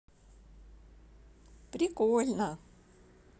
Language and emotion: Russian, positive